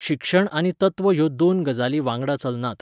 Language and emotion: Goan Konkani, neutral